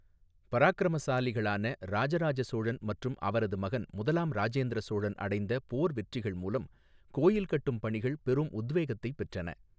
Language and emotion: Tamil, neutral